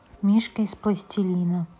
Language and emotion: Russian, neutral